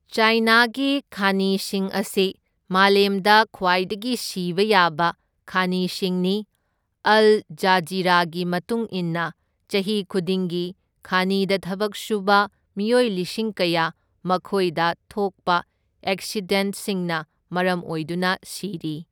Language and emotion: Manipuri, neutral